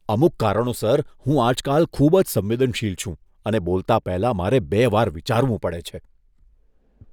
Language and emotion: Gujarati, disgusted